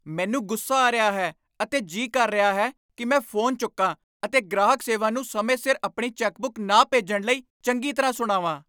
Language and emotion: Punjabi, angry